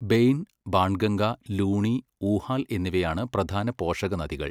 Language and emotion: Malayalam, neutral